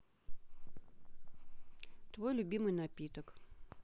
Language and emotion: Russian, neutral